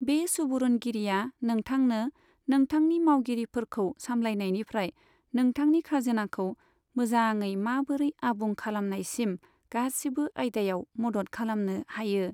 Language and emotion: Bodo, neutral